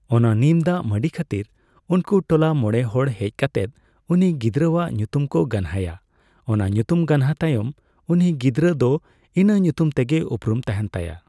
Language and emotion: Santali, neutral